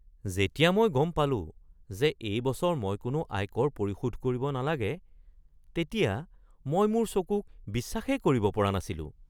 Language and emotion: Assamese, surprised